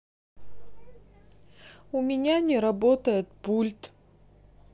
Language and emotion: Russian, sad